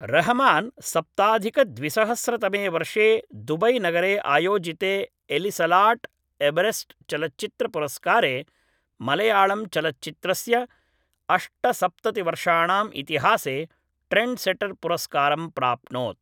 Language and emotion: Sanskrit, neutral